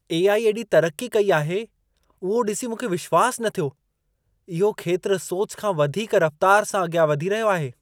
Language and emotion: Sindhi, surprised